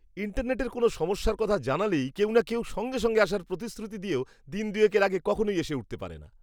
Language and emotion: Bengali, disgusted